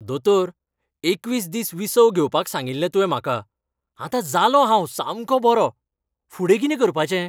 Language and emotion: Goan Konkani, happy